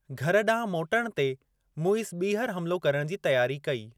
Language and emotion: Sindhi, neutral